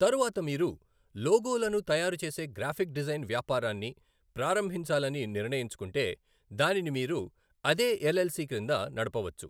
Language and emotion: Telugu, neutral